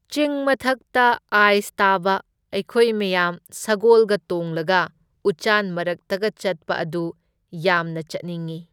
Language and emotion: Manipuri, neutral